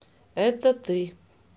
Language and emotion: Russian, neutral